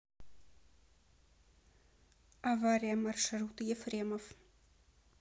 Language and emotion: Russian, neutral